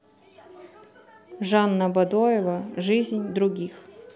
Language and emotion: Russian, neutral